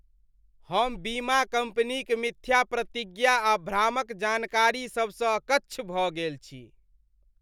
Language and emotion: Maithili, disgusted